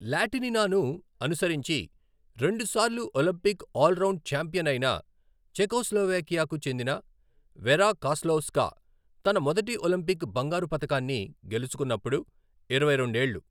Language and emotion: Telugu, neutral